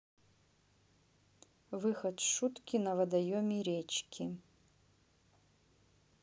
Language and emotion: Russian, neutral